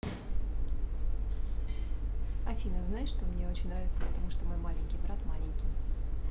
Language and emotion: Russian, positive